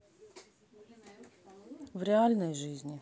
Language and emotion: Russian, neutral